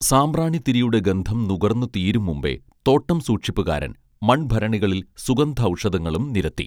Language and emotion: Malayalam, neutral